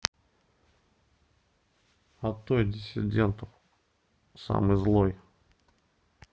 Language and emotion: Russian, neutral